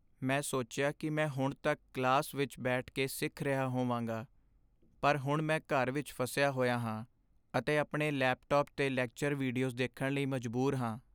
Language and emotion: Punjabi, sad